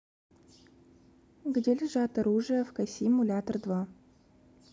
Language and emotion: Russian, neutral